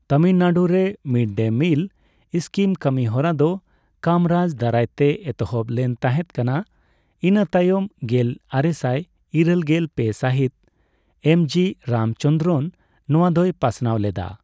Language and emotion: Santali, neutral